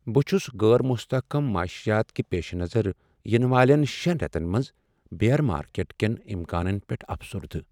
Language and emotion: Kashmiri, sad